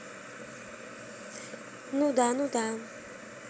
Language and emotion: Russian, neutral